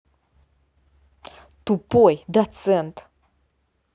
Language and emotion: Russian, angry